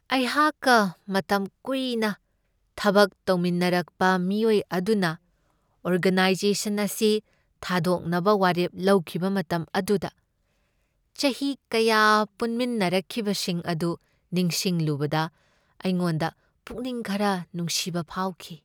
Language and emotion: Manipuri, sad